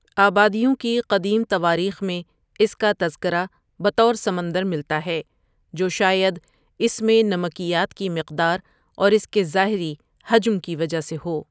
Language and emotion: Urdu, neutral